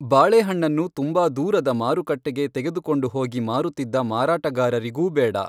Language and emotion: Kannada, neutral